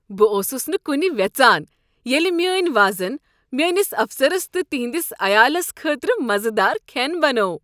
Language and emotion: Kashmiri, happy